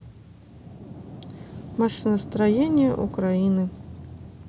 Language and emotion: Russian, neutral